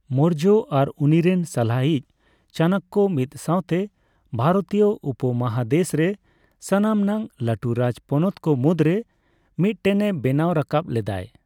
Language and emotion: Santali, neutral